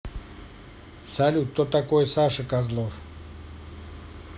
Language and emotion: Russian, neutral